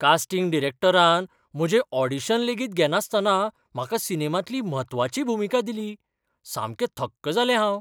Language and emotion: Goan Konkani, surprised